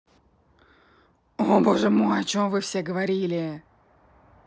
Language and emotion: Russian, angry